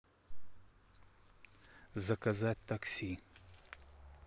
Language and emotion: Russian, neutral